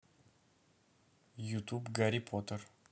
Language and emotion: Russian, neutral